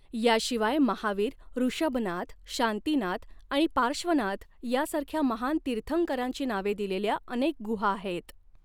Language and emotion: Marathi, neutral